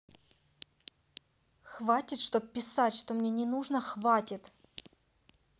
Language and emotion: Russian, angry